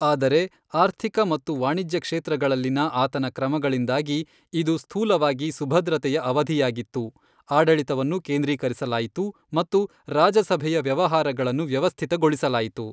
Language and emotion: Kannada, neutral